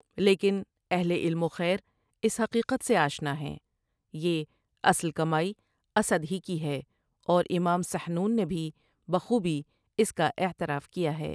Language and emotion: Urdu, neutral